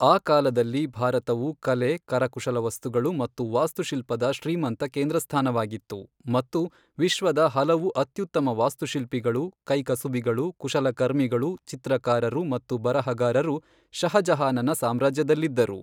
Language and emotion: Kannada, neutral